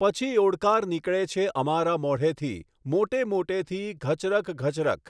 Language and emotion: Gujarati, neutral